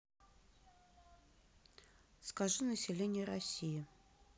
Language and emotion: Russian, neutral